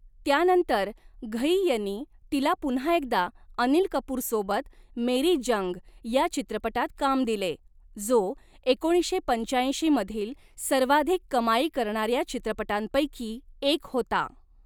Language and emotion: Marathi, neutral